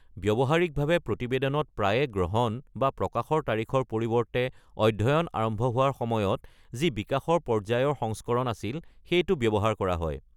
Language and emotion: Assamese, neutral